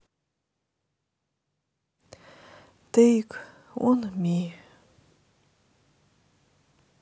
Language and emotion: Russian, sad